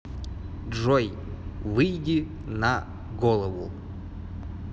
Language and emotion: Russian, neutral